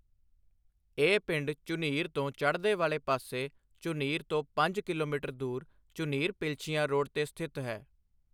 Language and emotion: Punjabi, neutral